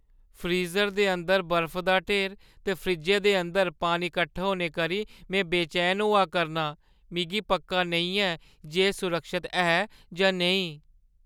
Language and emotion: Dogri, fearful